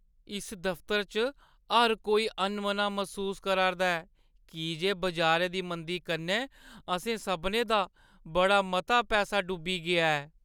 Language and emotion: Dogri, sad